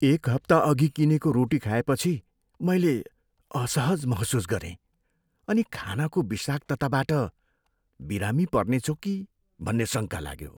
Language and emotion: Nepali, fearful